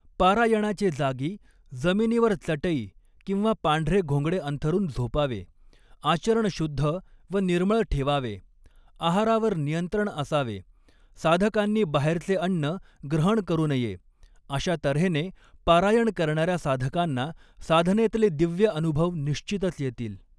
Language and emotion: Marathi, neutral